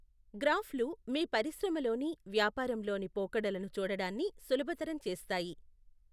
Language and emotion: Telugu, neutral